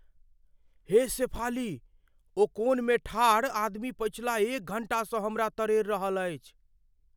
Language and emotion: Maithili, fearful